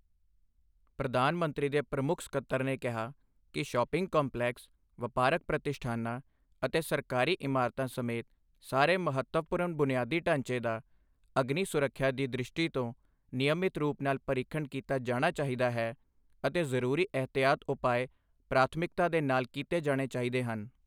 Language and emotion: Punjabi, neutral